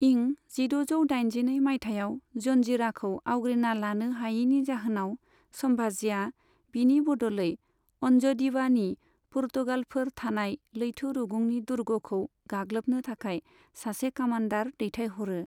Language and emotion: Bodo, neutral